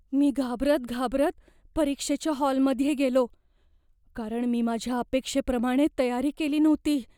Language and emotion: Marathi, fearful